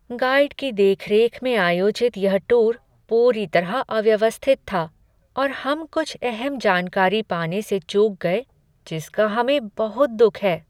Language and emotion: Hindi, sad